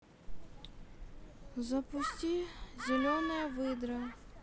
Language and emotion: Russian, sad